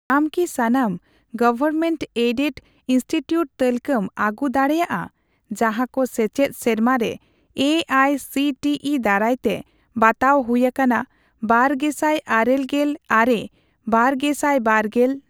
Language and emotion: Santali, neutral